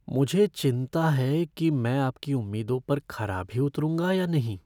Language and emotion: Hindi, fearful